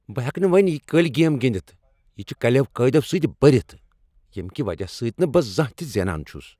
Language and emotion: Kashmiri, angry